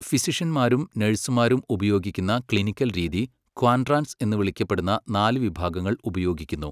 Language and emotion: Malayalam, neutral